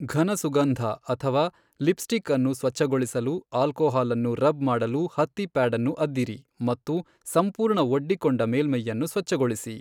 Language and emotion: Kannada, neutral